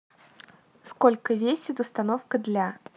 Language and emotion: Russian, neutral